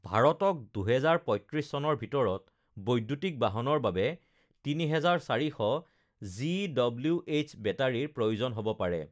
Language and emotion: Assamese, neutral